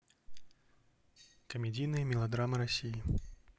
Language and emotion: Russian, neutral